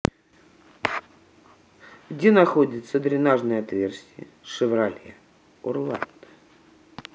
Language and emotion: Russian, neutral